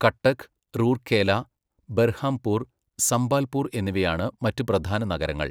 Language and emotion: Malayalam, neutral